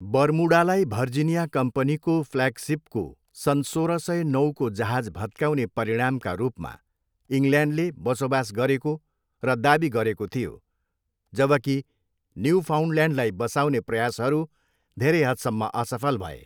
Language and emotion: Nepali, neutral